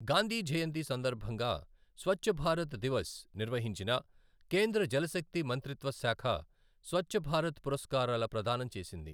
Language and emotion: Telugu, neutral